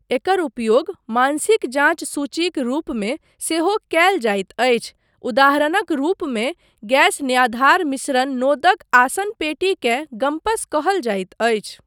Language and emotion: Maithili, neutral